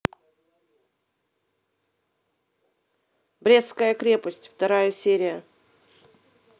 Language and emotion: Russian, neutral